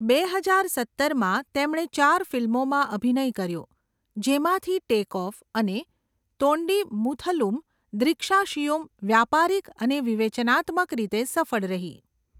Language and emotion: Gujarati, neutral